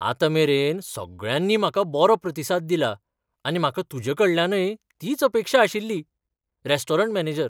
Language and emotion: Goan Konkani, surprised